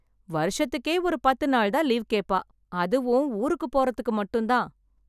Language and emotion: Tamil, happy